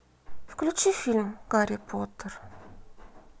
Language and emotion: Russian, sad